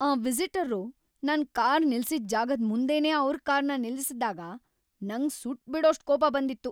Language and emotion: Kannada, angry